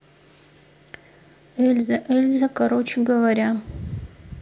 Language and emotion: Russian, neutral